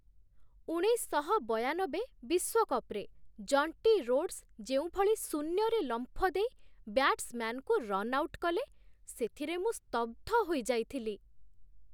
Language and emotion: Odia, surprised